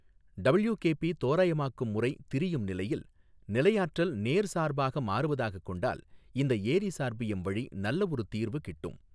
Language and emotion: Tamil, neutral